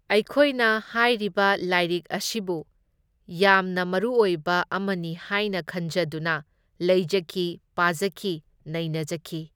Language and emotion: Manipuri, neutral